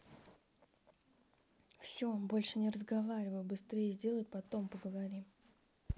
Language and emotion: Russian, angry